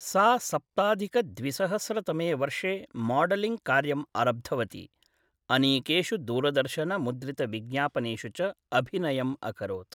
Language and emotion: Sanskrit, neutral